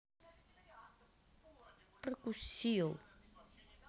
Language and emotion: Russian, sad